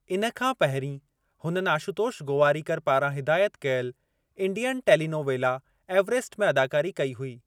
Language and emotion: Sindhi, neutral